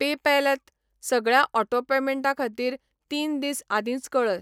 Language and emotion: Goan Konkani, neutral